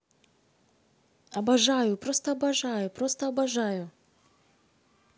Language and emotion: Russian, positive